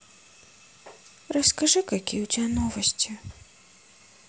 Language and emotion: Russian, sad